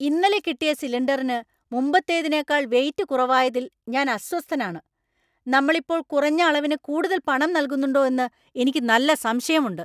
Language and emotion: Malayalam, angry